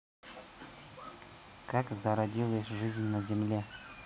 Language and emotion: Russian, neutral